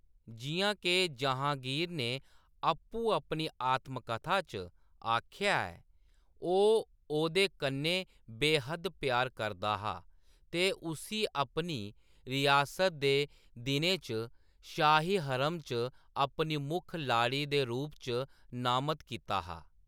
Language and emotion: Dogri, neutral